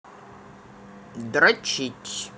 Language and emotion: Russian, neutral